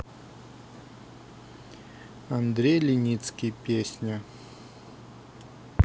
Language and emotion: Russian, neutral